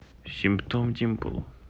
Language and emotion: Russian, neutral